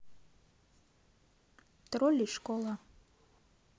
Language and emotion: Russian, neutral